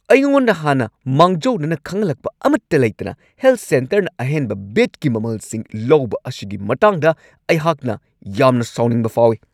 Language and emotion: Manipuri, angry